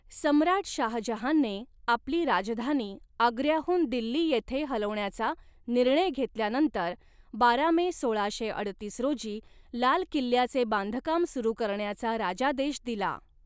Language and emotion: Marathi, neutral